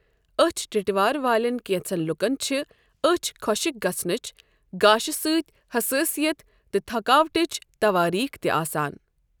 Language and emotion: Kashmiri, neutral